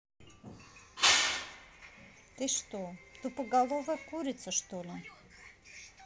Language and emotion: Russian, neutral